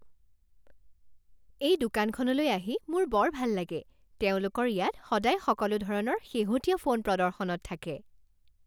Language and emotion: Assamese, happy